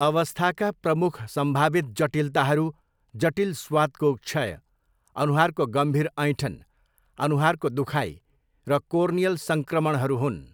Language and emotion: Nepali, neutral